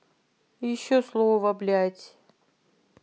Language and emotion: Russian, angry